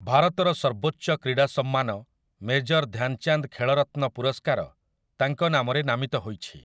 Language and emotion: Odia, neutral